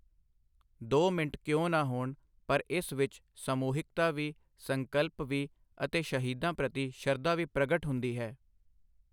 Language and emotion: Punjabi, neutral